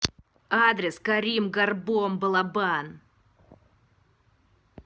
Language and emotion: Russian, angry